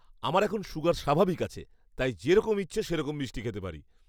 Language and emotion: Bengali, happy